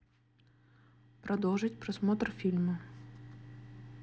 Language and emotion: Russian, neutral